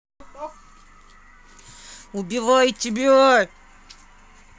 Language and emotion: Russian, angry